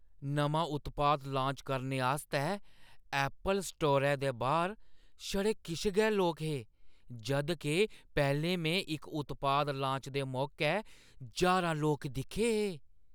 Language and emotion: Dogri, surprised